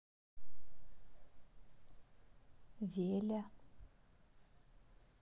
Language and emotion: Russian, neutral